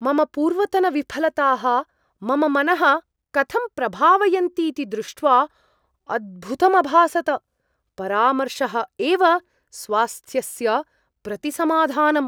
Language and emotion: Sanskrit, surprised